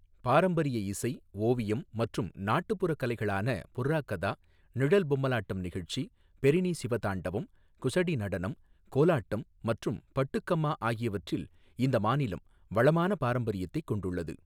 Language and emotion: Tamil, neutral